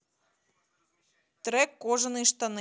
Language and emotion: Russian, neutral